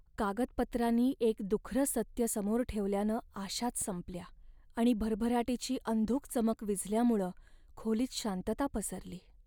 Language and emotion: Marathi, sad